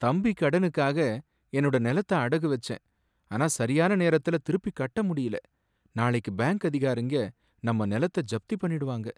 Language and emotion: Tamil, sad